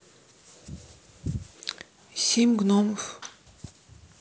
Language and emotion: Russian, neutral